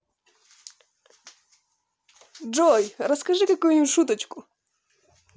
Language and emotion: Russian, positive